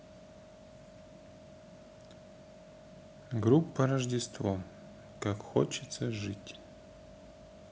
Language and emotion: Russian, neutral